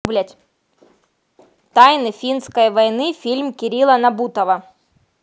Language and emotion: Russian, neutral